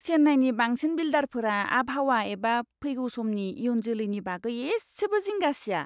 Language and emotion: Bodo, disgusted